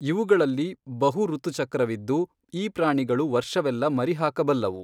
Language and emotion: Kannada, neutral